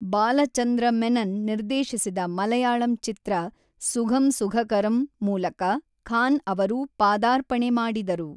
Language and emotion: Kannada, neutral